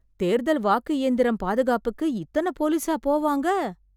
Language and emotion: Tamil, surprised